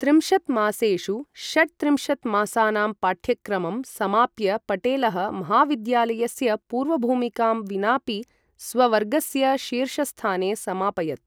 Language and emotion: Sanskrit, neutral